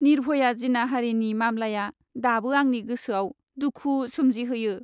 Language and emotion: Bodo, sad